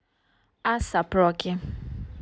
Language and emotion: Russian, neutral